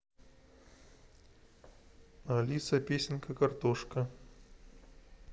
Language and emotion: Russian, neutral